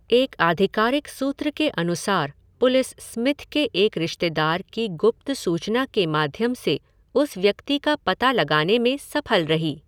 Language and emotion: Hindi, neutral